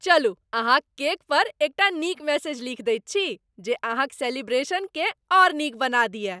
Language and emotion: Maithili, happy